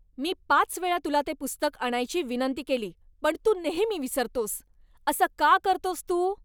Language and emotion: Marathi, angry